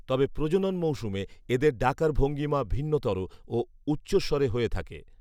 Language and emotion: Bengali, neutral